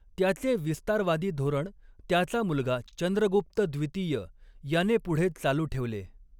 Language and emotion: Marathi, neutral